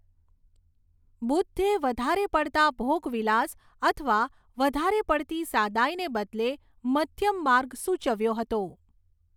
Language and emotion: Gujarati, neutral